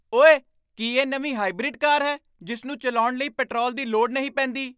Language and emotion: Punjabi, surprised